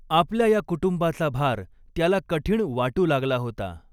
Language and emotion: Marathi, neutral